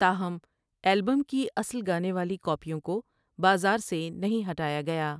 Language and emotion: Urdu, neutral